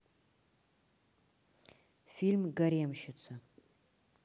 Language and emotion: Russian, neutral